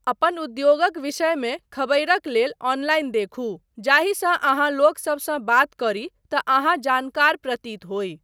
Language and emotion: Maithili, neutral